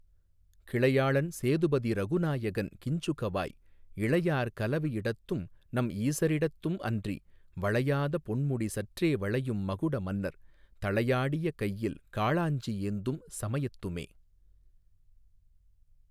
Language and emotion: Tamil, neutral